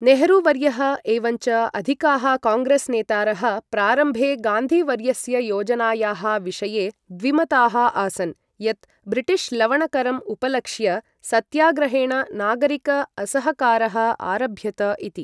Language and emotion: Sanskrit, neutral